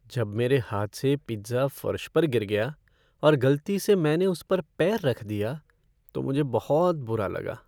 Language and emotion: Hindi, sad